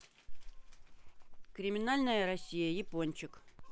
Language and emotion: Russian, neutral